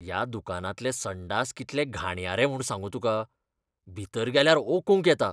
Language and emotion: Goan Konkani, disgusted